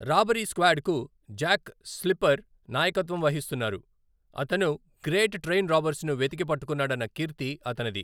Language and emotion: Telugu, neutral